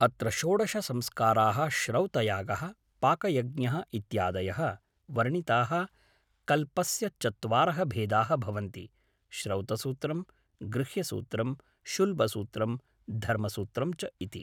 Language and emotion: Sanskrit, neutral